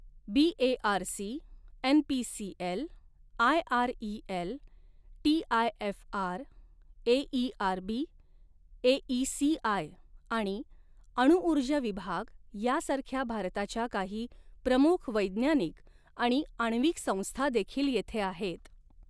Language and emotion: Marathi, neutral